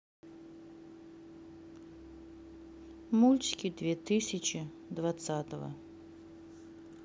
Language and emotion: Russian, neutral